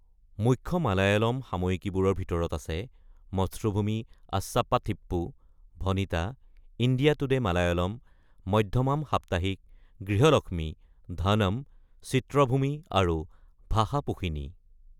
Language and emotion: Assamese, neutral